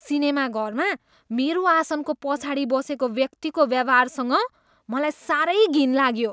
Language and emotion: Nepali, disgusted